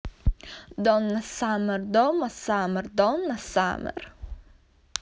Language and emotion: Russian, neutral